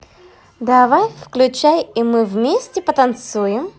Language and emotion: Russian, positive